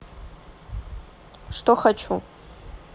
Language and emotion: Russian, neutral